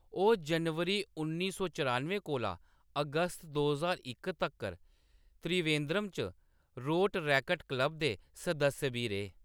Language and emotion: Dogri, neutral